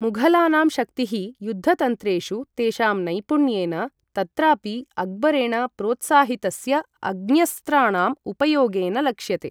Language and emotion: Sanskrit, neutral